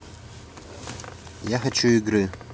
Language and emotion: Russian, neutral